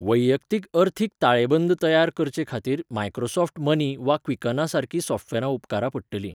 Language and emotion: Goan Konkani, neutral